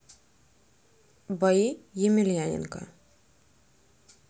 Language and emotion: Russian, neutral